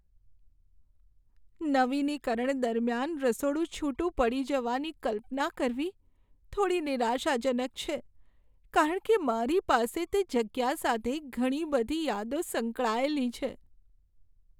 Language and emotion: Gujarati, sad